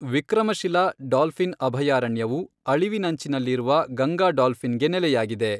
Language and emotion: Kannada, neutral